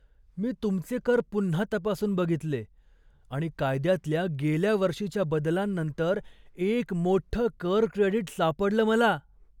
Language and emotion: Marathi, surprised